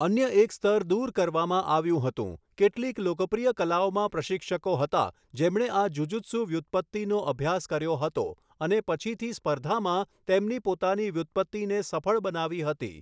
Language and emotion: Gujarati, neutral